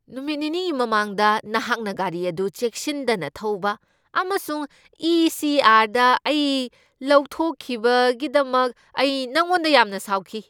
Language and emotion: Manipuri, angry